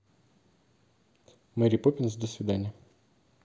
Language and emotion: Russian, neutral